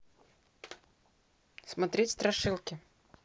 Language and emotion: Russian, neutral